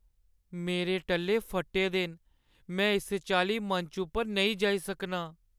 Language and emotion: Dogri, sad